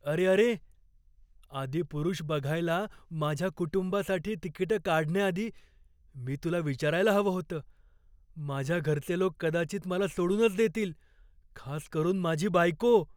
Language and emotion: Marathi, fearful